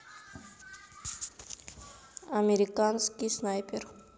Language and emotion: Russian, neutral